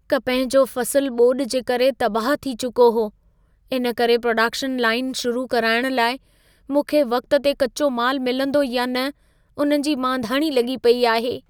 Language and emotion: Sindhi, fearful